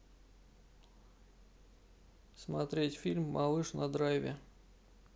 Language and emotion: Russian, neutral